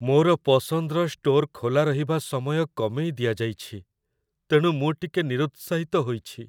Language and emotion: Odia, sad